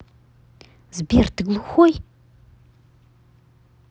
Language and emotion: Russian, angry